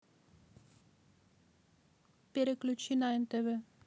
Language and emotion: Russian, neutral